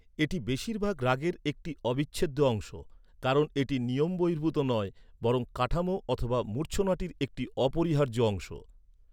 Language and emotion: Bengali, neutral